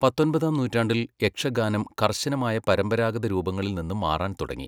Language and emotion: Malayalam, neutral